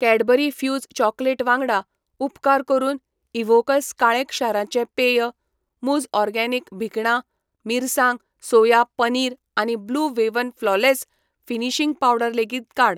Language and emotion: Goan Konkani, neutral